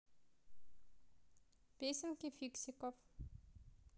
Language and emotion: Russian, neutral